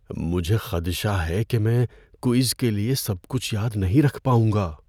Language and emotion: Urdu, fearful